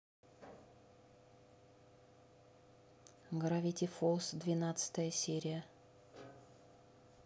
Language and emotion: Russian, neutral